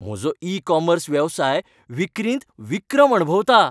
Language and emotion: Goan Konkani, happy